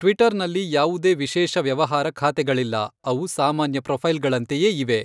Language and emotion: Kannada, neutral